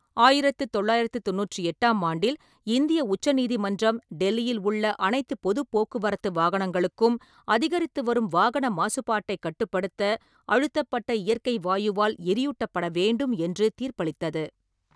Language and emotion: Tamil, neutral